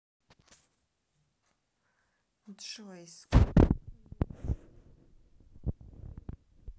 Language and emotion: Russian, neutral